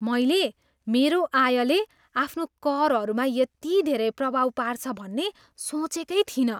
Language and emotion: Nepali, surprised